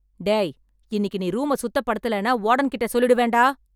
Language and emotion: Tamil, angry